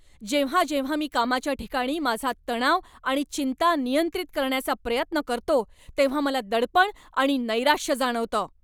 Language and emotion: Marathi, angry